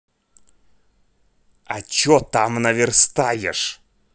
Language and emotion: Russian, neutral